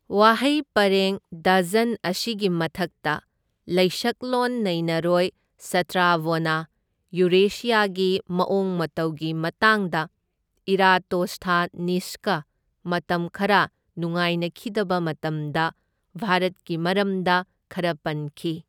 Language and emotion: Manipuri, neutral